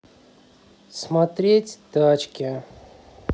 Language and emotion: Russian, neutral